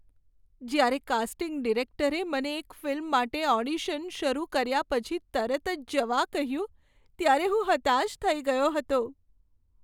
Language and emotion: Gujarati, sad